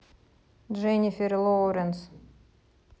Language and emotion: Russian, neutral